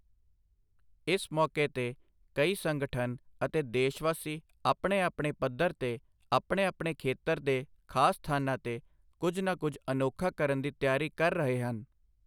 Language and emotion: Punjabi, neutral